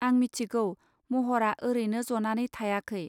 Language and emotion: Bodo, neutral